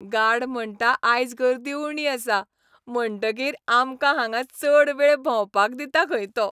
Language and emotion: Goan Konkani, happy